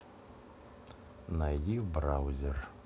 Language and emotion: Russian, neutral